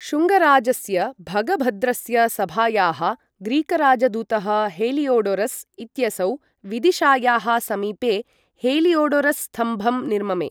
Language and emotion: Sanskrit, neutral